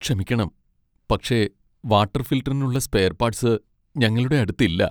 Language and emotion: Malayalam, sad